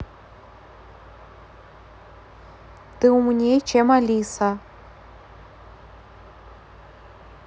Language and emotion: Russian, neutral